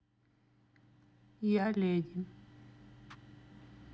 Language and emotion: Russian, neutral